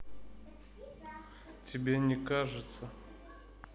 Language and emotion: Russian, neutral